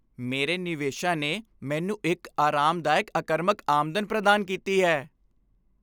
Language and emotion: Punjabi, happy